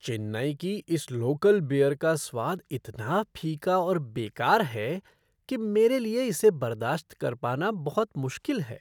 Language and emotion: Hindi, disgusted